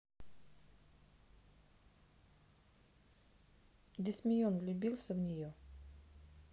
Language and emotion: Russian, neutral